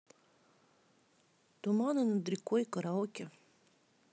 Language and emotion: Russian, neutral